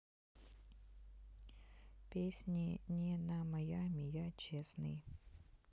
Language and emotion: Russian, neutral